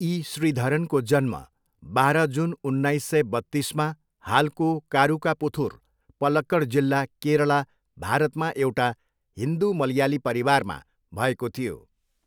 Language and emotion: Nepali, neutral